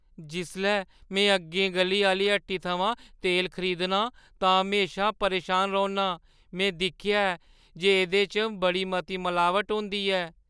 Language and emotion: Dogri, fearful